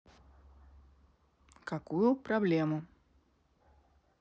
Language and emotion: Russian, neutral